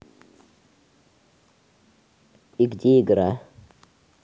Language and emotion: Russian, neutral